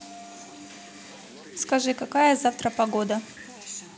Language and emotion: Russian, neutral